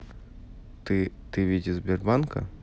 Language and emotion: Russian, neutral